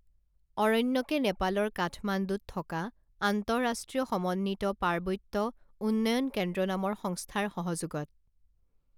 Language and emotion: Assamese, neutral